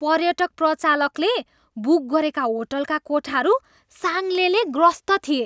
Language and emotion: Nepali, disgusted